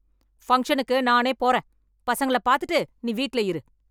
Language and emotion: Tamil, angry